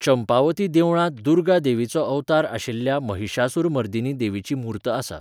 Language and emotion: Goan Konkani, neutral